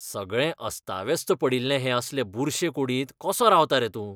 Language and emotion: Goan Konkani, disgusted